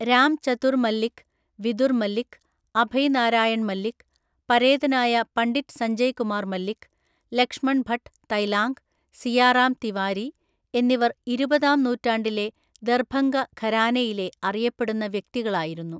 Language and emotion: Malayalam, neutral